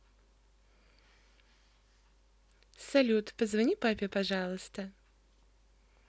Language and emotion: Russian, positive